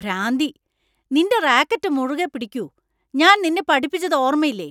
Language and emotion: Malayalam, angry